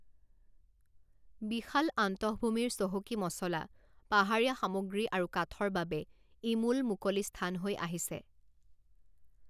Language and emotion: Assamese, neutral